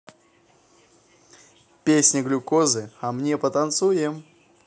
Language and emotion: Russian, positive